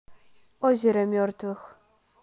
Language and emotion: Russian, neutral